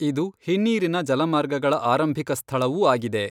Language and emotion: Kannada, neutral